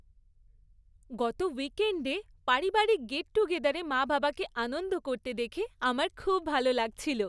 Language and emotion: Bengali, happy